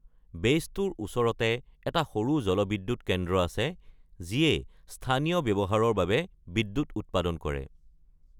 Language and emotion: Assamese, neutral